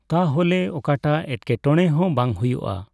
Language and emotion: Santali, neutral